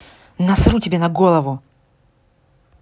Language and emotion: Russian, angry